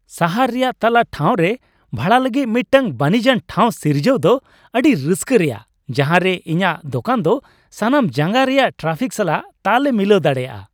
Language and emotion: Santali, happy